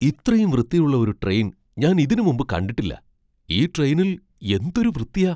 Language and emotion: Malayalam, surprised